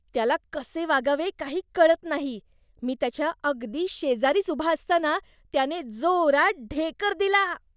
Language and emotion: Marathi, disgusted